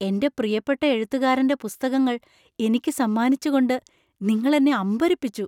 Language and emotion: Malayalam, surprised